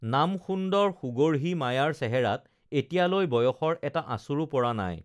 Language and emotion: Assamese, neutral